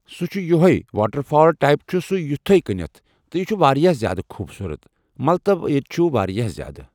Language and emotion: Kashmiri, neutral